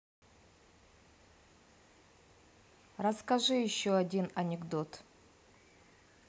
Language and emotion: Russian, neutral